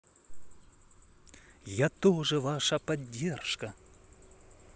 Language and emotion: Russian, positive